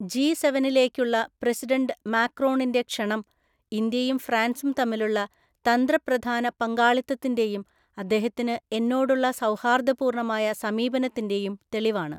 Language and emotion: Malayalam, neutral